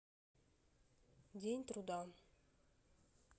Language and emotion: Russian, neutral